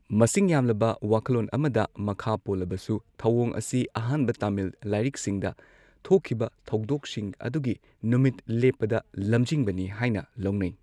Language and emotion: Manipuri, neutral